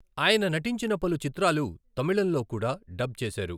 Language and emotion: Telugu, neutral